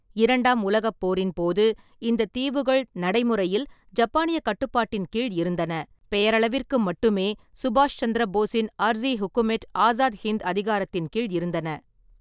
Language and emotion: Tamil, neutral